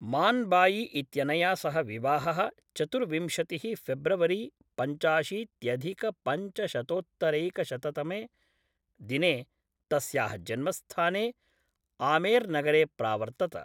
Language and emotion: Sanskrit, neutral